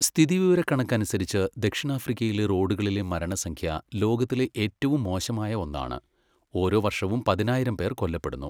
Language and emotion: Malayalam, neutral